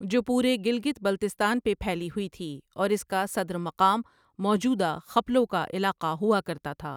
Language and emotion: Urdu, neutral